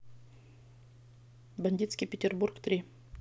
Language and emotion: Russian, neutral